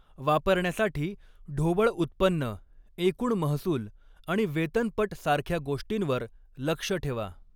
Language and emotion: Marathi, neutral